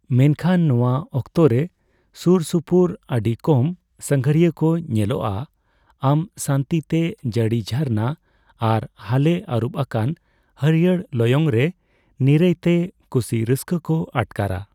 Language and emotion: Santali, neutral